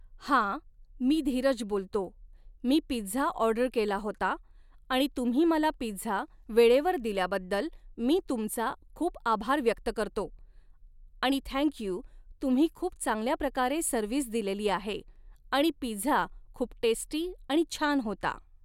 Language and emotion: Marathi, neutral